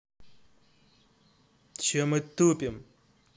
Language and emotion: Russian, angry